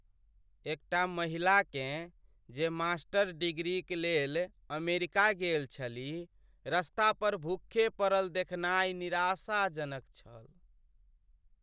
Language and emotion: Maithili, sad